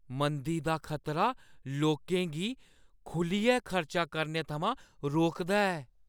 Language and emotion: Dogri, fearful